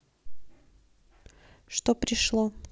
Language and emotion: Russian, neutral